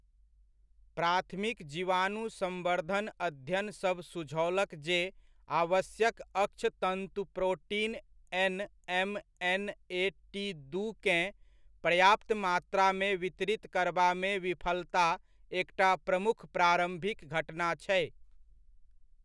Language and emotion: Maithili, neutral